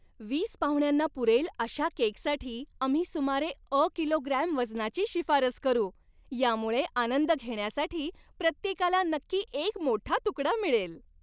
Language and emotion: Marathi, happy